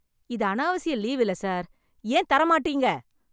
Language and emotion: Tamil, angry